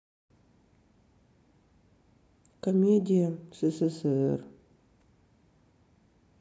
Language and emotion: Russian, sad